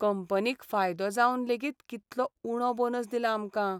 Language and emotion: Goan Konkani, sad